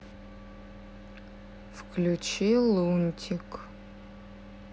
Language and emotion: Russian, neutral